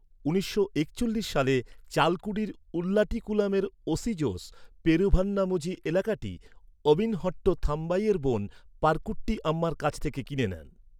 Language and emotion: Bengali, neutral